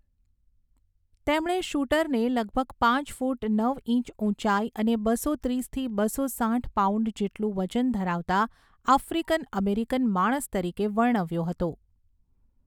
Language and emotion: Gujarati, neutral